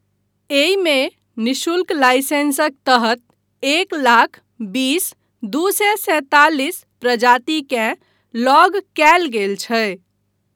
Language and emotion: Maithili, neutral